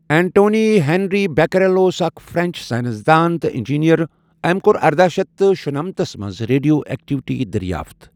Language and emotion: Kashmiri, neutral